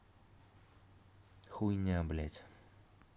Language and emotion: Russian, angry